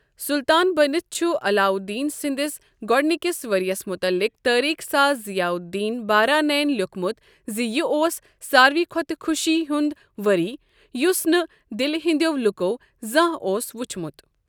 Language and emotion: Kashmiri, neutral